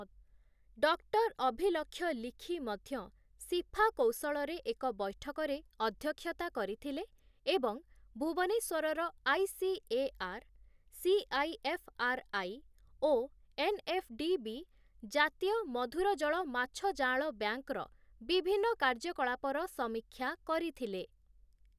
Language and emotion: Odia, neutral